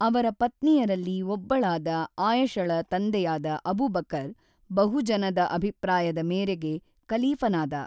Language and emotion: Kannada, neutral